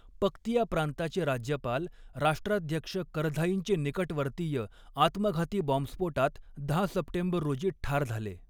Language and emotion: Marathi, neutral